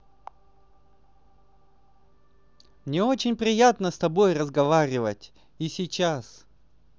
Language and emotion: Russian, positive